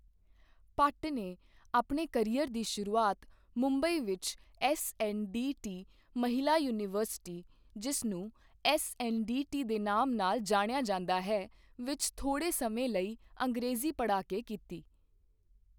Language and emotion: Punjabi, neutral